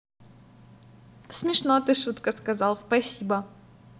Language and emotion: Russian, positive